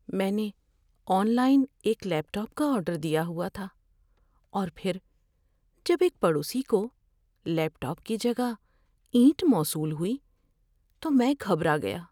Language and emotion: Urdu, fearful